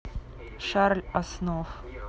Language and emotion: Russian, neutral